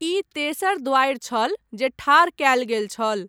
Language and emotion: Maithili, neutral